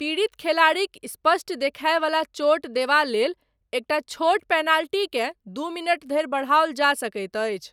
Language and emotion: Maithili, neutral